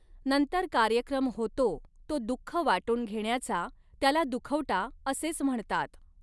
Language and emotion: Marathi, neutral